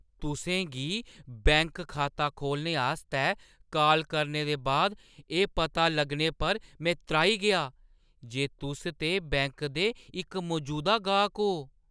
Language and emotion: Dogri, surprised